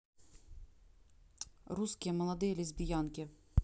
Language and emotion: Russian, neutral